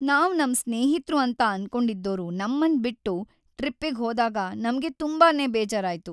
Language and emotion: Kannada, sad